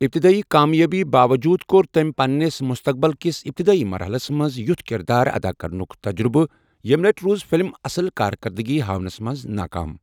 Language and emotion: Kashmiri, neutral